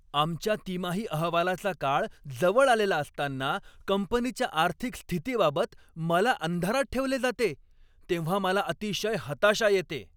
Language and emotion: Marathi, angry